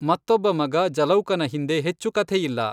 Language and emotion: Kannada, neutral